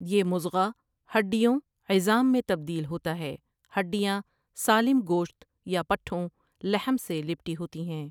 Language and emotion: Urdu, neutral